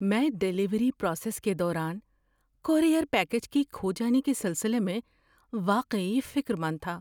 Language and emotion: Urdu, fearful